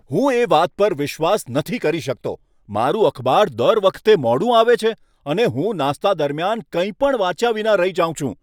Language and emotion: Gujarati, angry